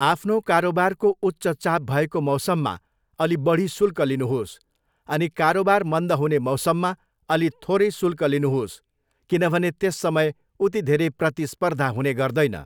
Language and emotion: Nepali, neutral